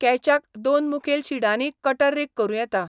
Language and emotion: Goan Konkani, neutral